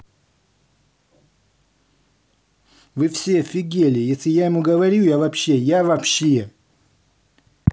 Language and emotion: Russian, angry